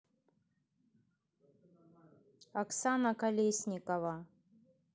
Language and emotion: Russian, neutral